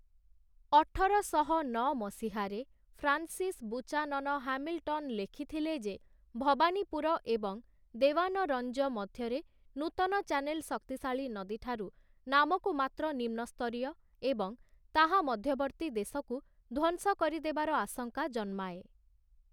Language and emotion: Odia, neutral